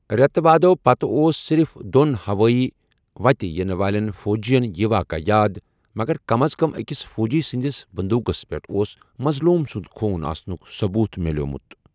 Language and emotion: Kashmiri, neutral